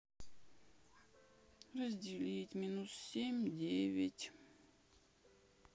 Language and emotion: Russian, sad